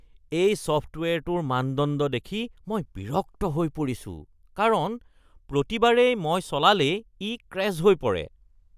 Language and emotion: Assamese, disgusted